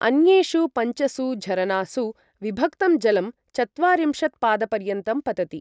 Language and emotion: Sanskrit, neutral